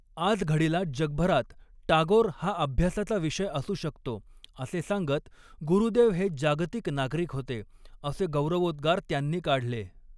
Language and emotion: Marathi, neutral